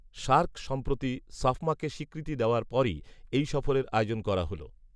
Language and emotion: Bengali, neutral